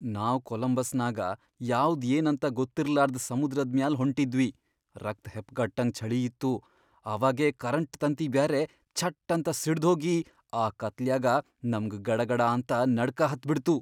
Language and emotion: Kannada, fearful